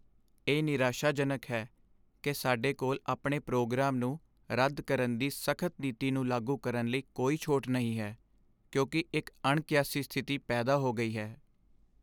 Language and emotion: Punjabi, sad